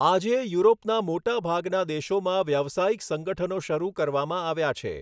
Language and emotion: Gujarati, neutral